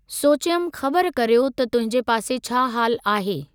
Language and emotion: Sindhi, neutral